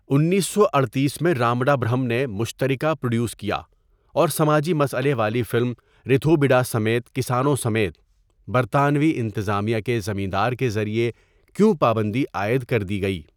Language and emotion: Urdu, neutral